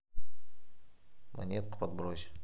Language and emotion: Russian, neutral